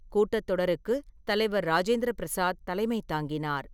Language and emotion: Tamil, neutral